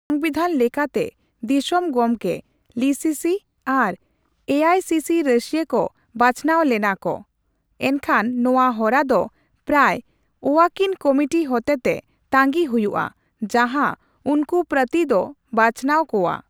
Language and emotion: Santali, neutral